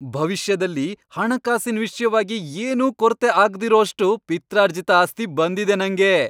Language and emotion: Kannada, happy